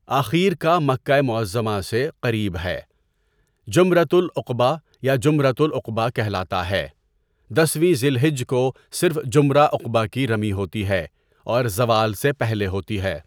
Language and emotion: Urdu, neutral